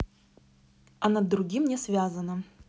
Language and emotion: Russian, neutral